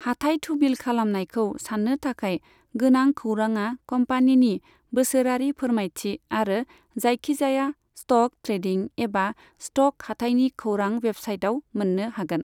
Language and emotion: Bodo, neutral